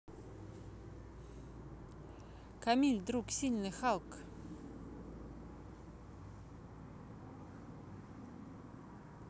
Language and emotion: Russian, neutral